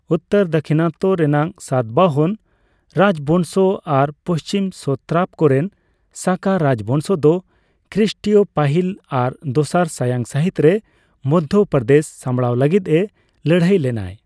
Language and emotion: Santali, neutral